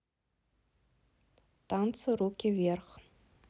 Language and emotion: Russian, neutral